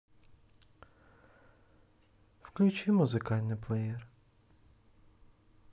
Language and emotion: Russian, sad